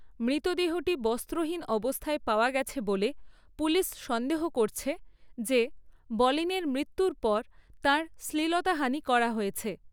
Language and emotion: Bengali, neutral